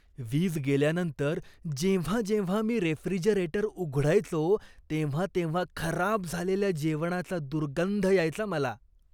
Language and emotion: Marathi, disgusted